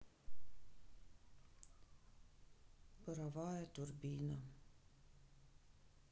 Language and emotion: Russian, sad